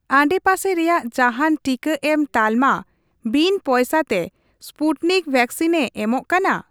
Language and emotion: Santali, neutral